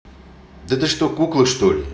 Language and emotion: Russian, angry